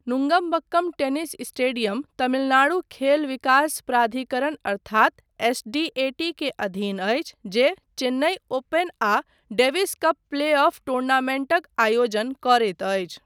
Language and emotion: Maithili, neutral